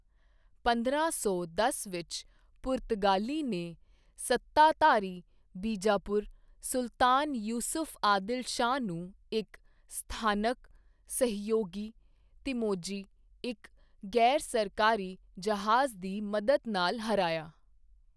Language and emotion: Punjabi, neutral